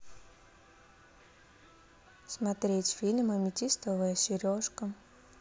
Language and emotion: Russian, neutral